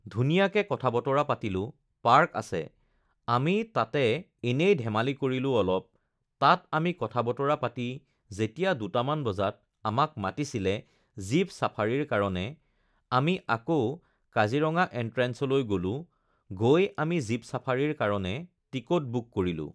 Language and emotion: Assamese, neutral